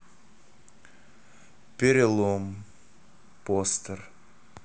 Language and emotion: Russian, sad